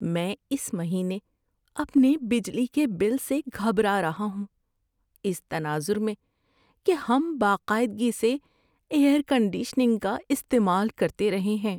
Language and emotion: Urdu, fearful